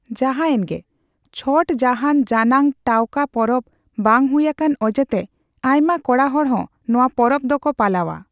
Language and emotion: Santali, neutral